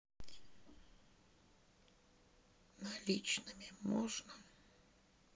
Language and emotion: Russian, sad